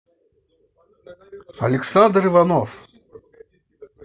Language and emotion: Russian, positive